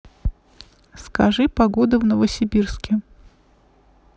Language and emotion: Russian, neutral